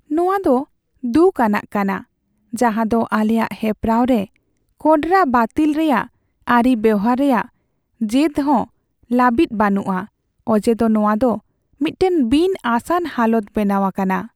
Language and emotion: Santali, sad